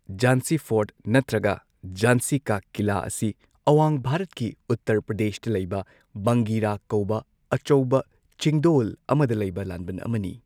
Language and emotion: Manipuri, neutral